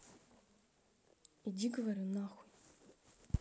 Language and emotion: Russian, angry